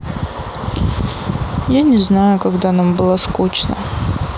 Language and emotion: Russian, sad